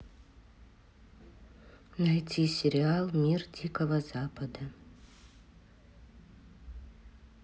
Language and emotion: Russian, neutral